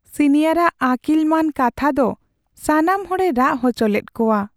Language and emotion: Santali, sad